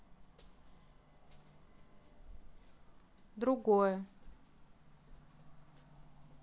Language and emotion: Russian, neutral